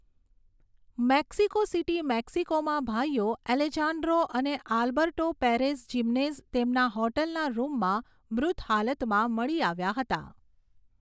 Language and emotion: Gujarati, neutral